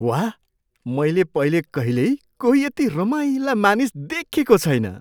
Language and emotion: Nepali, surprised